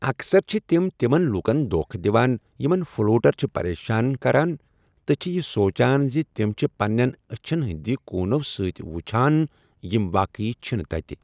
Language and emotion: Kashmiri, neutral